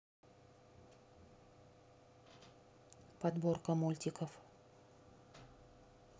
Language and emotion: Russian, neutral